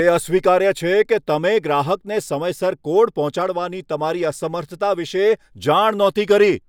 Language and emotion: Gujarati, angry